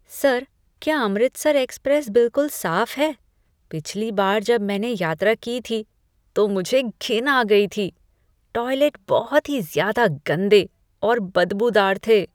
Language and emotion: Hindi, disgusted